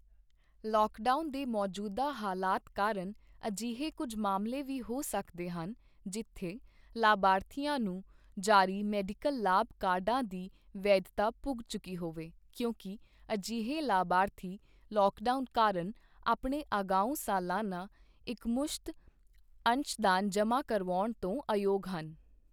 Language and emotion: Punjabi, neutral